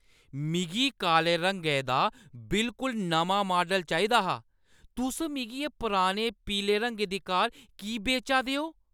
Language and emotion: Dogri, angry